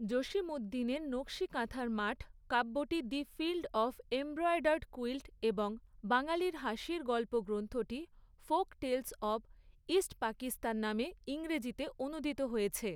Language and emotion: Bengali, neutral